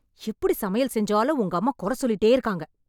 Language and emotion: Tamil, angry